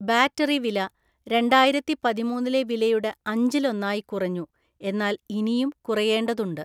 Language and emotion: Malayalam, neutral